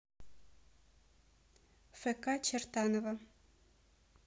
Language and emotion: Russian, neutral